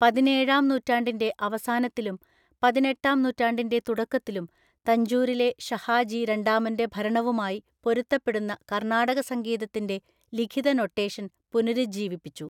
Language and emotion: Malayalam, neutral